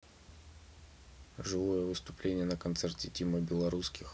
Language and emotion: Russian, neutral